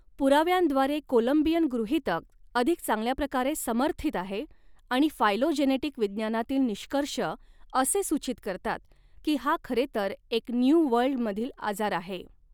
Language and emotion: Marathi, neutral